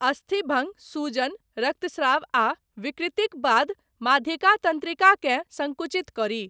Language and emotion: Maithili, neutral